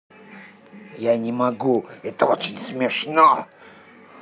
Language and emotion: Russian, angry